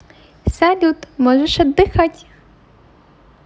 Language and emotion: Russian, positive